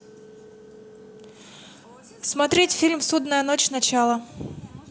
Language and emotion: Russian, neutral